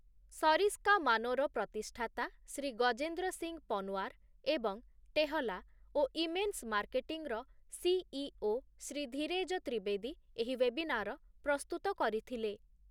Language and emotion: Odia, neutral